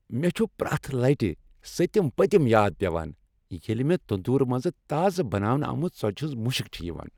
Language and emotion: Kashmiri, happy